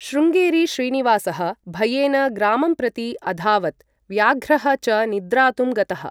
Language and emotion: Sanskrit, neutral